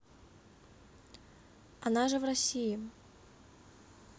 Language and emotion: Russian, neutral